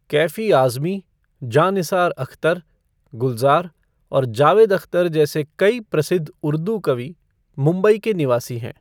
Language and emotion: Hindi, neutral